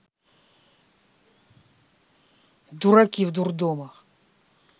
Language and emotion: Russian, angry